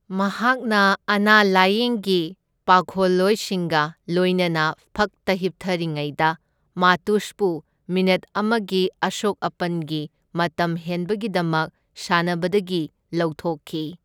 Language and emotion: Manipuri, neutral